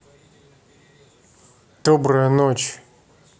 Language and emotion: Russian, neutral